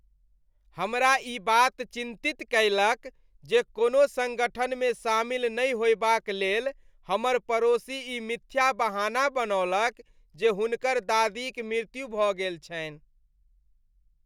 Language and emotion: Maithili, disgusted